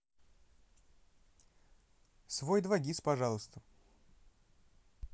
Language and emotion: Russian, neutral